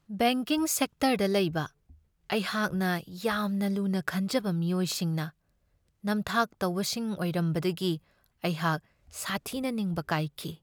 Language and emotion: Manipuri, sad